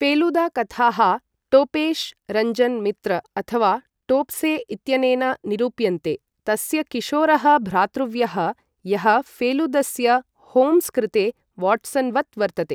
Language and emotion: Sanskrit, neutral